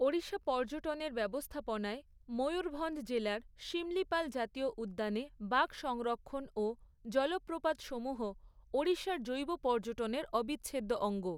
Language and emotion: Bengali, neutral